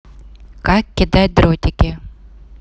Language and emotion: Russian, neutral